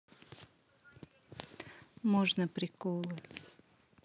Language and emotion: Russian, neutral